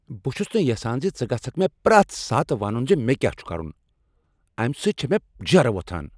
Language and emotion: Kashmiri, angry